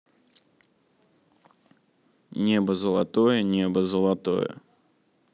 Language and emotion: Russian, neutral